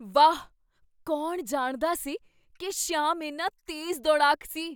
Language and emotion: Punjabi, surprised